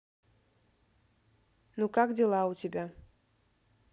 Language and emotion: Russian, neutral